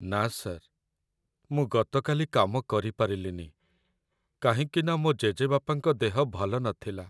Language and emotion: Odia, sad